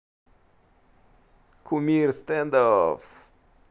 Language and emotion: Russian, positive